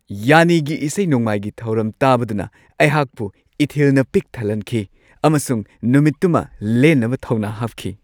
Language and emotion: Manipuri, happy